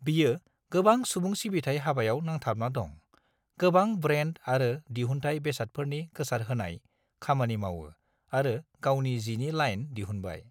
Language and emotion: Bodo, neutral